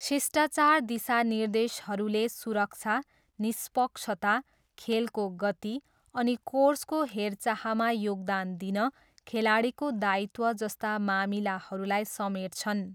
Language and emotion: Nepali, neutral